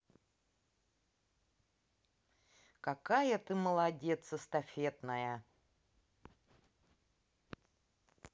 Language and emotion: Russian, positive